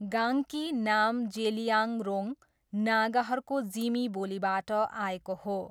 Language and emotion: Nepali, neutral